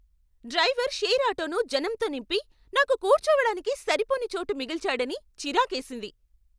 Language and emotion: Telugu, angry